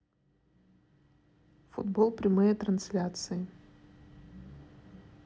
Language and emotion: Russian, neutral